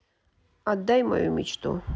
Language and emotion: Russian, sad